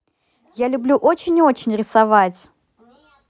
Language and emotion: Russian, positive